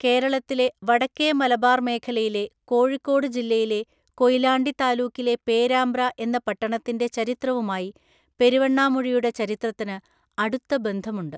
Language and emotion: Malayalam, neutral